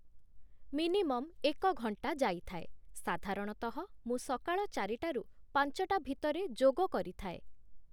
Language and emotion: Odia, neutral